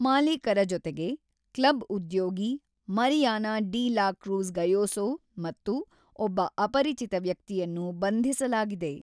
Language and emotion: Kannada, neutral